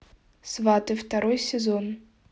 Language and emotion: Russian, neutral